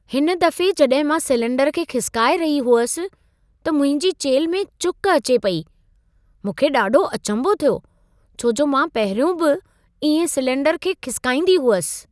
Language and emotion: Sindhi, surprised